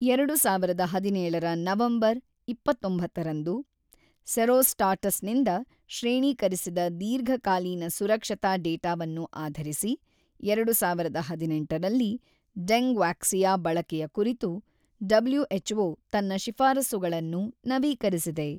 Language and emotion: Kannada, neutral